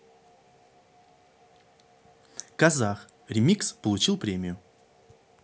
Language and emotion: Russian, neutral